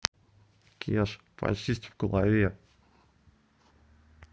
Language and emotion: Russian, neutral